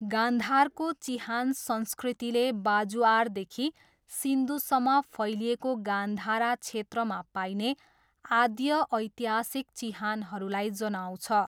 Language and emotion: Nepali, neutral